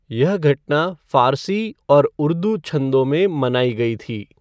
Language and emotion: Hindi, neutral